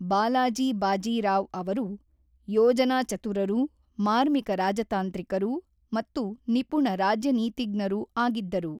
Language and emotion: Kannada, neutral